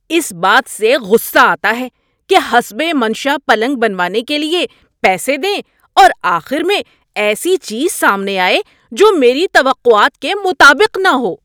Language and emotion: Urdu, angry